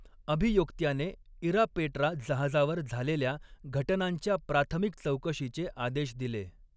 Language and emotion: Marathi, neutral